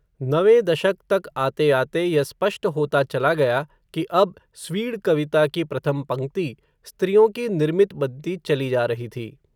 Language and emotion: Hindi, neutral